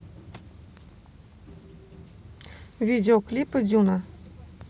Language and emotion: Russian, neutral